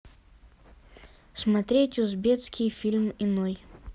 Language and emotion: Russian, neutral